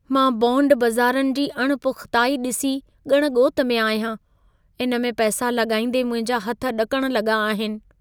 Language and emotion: Sindhi, fearful